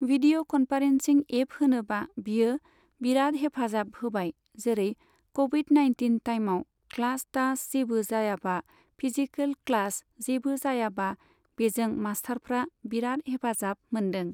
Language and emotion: Bodo, neutral